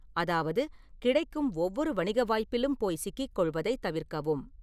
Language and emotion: Tamil, neutral